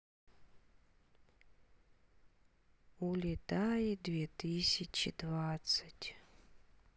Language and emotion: Russian, sad